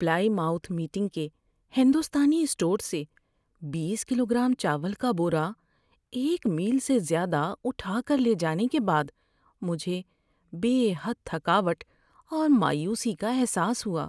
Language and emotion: Urdu, sad